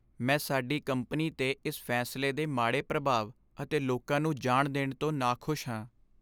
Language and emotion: Punjabi, sad